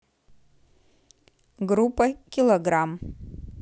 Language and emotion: Russian, neutral